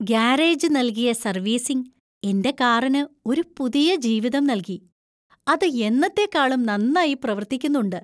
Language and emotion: Malayalam, happy